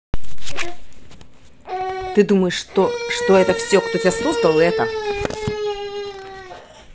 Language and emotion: Russian, angry